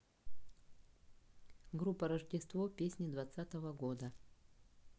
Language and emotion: Russian, neutral